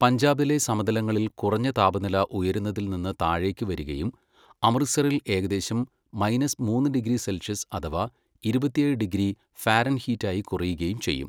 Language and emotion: Malayalam, neutral